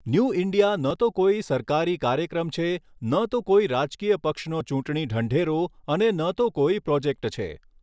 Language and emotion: Gujarati, neutral